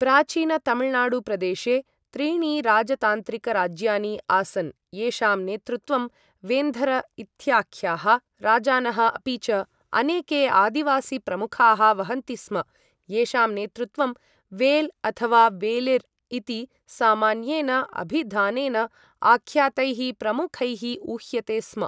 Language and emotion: Sanskrit, neutral